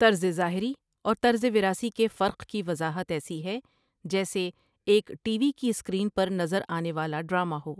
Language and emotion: Urdu, neutral